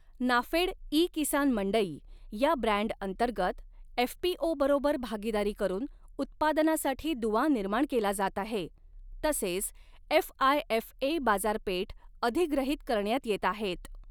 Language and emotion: Marathi, neutral